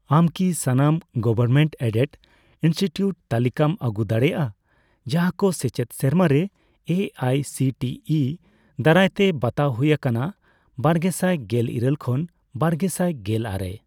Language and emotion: Santali, neutral